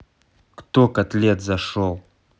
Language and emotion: Russian, angry